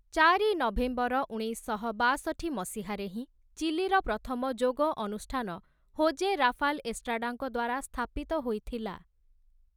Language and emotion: Odia, neutral